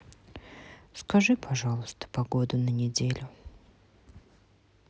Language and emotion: Russian, sad